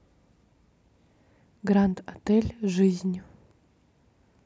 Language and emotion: Russian, neutral